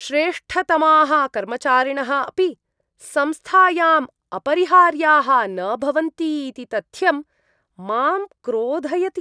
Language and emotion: Sanskrit, disgusted